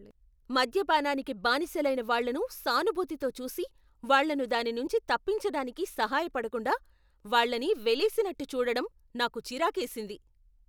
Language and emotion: Telugu, angry